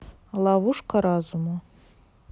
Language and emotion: Russian, neutral